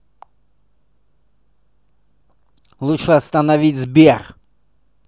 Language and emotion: Russian, angry